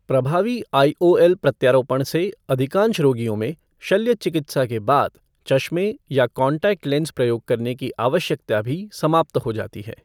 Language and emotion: Hindi, neutral